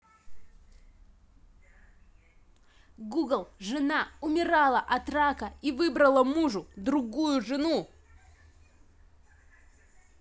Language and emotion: Russian, angry